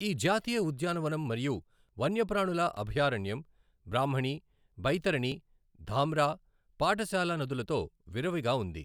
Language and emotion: Telugu, neutral